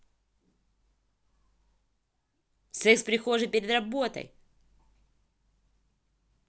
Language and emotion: Russian, angry